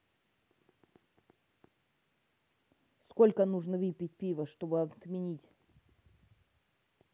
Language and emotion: Russian, neutral